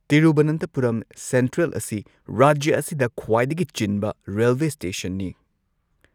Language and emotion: Manipuri, neutral